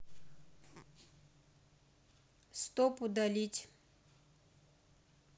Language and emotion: Russian, neutral